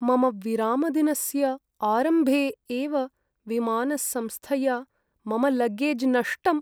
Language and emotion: Sanskrit, sad